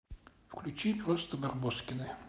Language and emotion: Russian, neutral